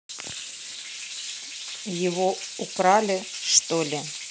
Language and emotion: Russian, neutral